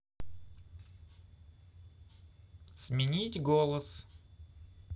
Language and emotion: Russian, neutral